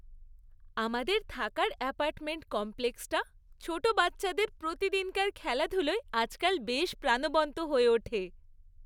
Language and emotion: Bengali, happy